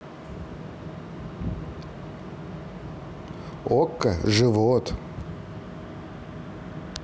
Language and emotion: Russian, neutral